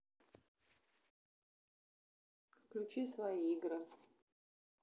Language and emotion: Russian, neutral